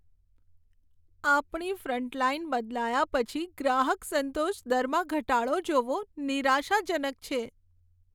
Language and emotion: Gujarati, sad